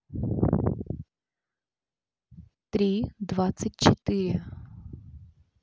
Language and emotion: Russian, neutral